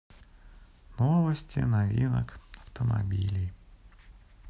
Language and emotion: Russian, sad